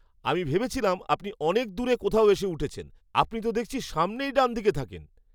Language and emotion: Bengali, surprised